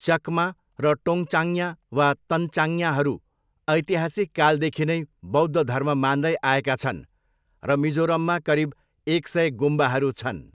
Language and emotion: Nepali, neutral